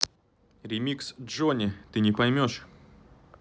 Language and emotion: Russian, neutral